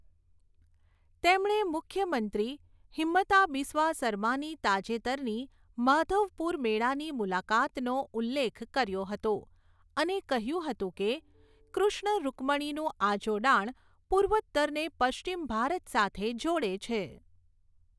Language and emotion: Gujarati, neutral